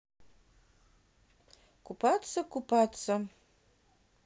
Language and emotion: Russian, neutral